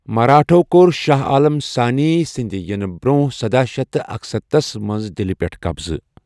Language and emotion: Kashmiri, neutral